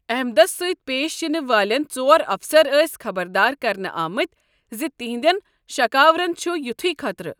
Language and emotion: Kashmiri, neutral